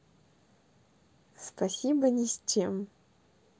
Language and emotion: Russian, neutral